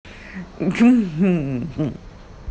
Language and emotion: Russian, positive